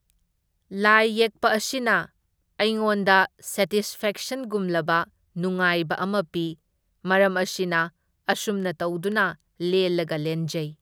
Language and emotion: Manipuri, neutral